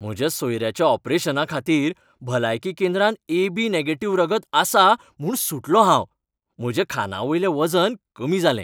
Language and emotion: Goan Konkani, happy